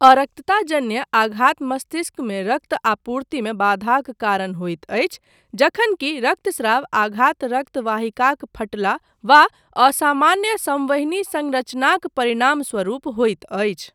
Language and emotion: Maithili, neutral